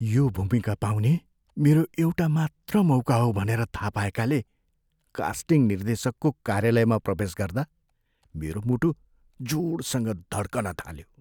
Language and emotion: Nepali, fearful